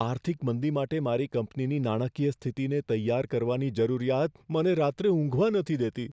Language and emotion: Gujarati, fearful